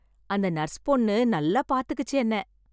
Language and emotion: Tamil, happy